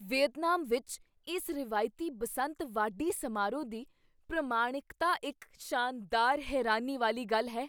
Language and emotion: Punjabi, surprised